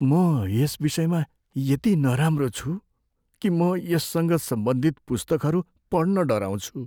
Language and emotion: Nepali, fearful